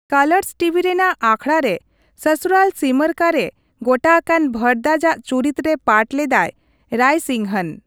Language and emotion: Santali, neutral